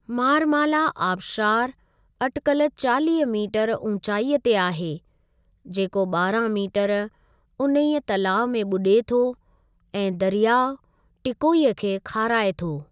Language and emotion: Sindhi, neutral